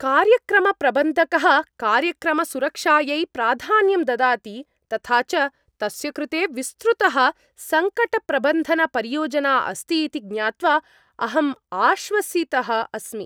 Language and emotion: Sanskrit, happy